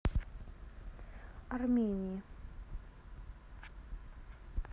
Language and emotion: Russian, neutral